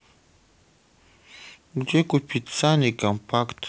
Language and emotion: Russian, neutral